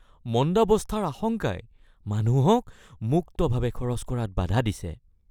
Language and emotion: Assamese, fearful